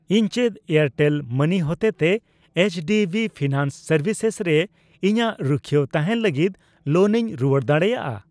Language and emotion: Santali, neutral